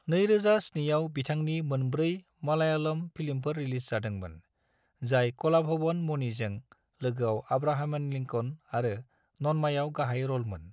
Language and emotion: Bodo, neutral